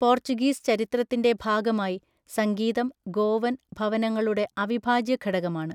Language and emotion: Malayalam, neutral